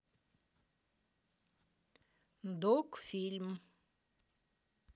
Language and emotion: Russian, neutral